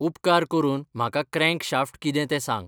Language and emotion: Goan Konkani, neutral